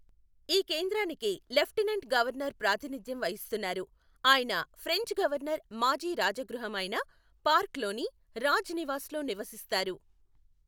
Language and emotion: Telugu, neutral